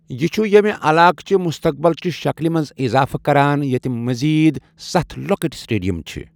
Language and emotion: Kashmiri, neutral